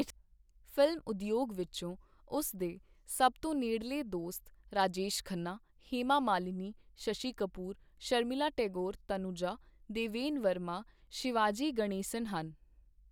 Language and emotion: Punjabi, neutral